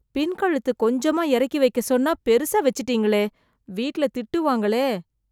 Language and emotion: Tamil, fearful